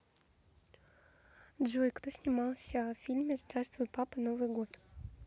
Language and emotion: Russian, neutral